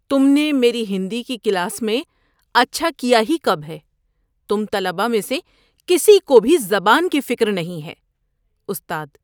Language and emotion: Urdu, disgusted